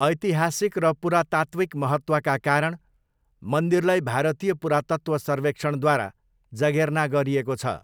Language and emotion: Nepali, neutral